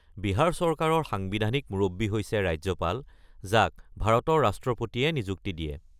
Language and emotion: Assamese, neutral